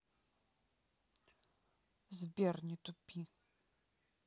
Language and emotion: Russian, neutral